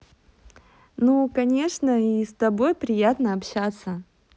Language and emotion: Russian, positive